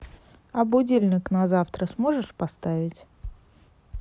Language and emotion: Russian, neutral